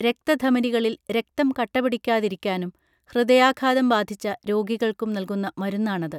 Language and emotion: Malayalam, neutral